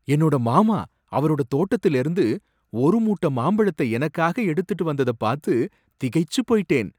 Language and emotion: Tamil, surprised